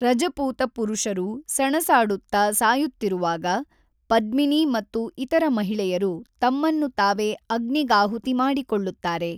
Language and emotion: Kannada, neutral